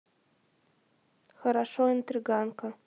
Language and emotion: Russian, neutral